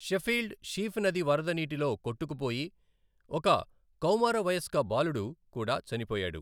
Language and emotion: Telugu, neutral